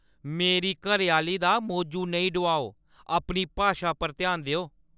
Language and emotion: Dogri, angry